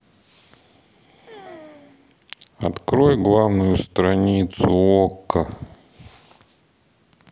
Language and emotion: Russian, neutral